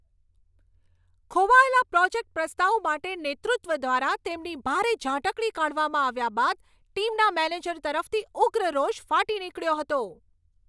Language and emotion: Gujarati, angry